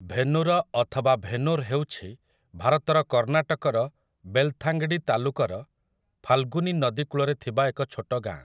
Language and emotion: Odia, neutral